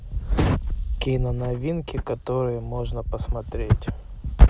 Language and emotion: Russian, neutral